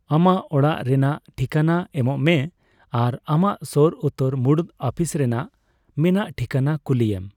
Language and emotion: Santali, neutral